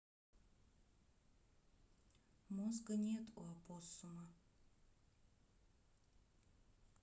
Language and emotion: Russian, neutral